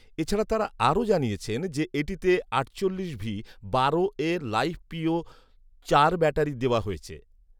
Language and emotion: Bengali, neutral